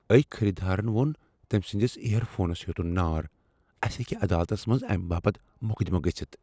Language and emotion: Kashmiri, fearful